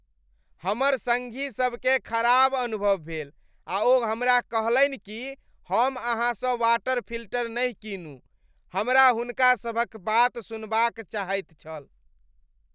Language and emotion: Maithili, disgusted